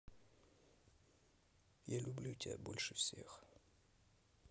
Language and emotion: Russian, neutral